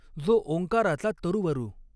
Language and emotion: Marathi, neutral